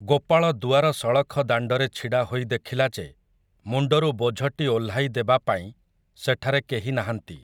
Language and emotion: Odia, neutral